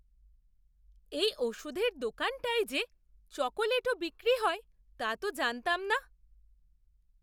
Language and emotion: Bengali, surprised